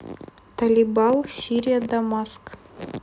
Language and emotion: Russian, neutral